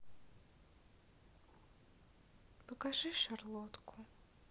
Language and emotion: Russian, sad